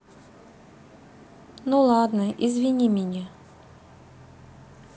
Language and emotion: Russian, neutral